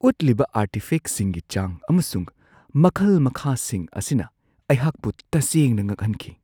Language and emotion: Manipuri, surprised